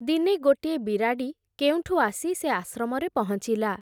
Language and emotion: Odia, neutral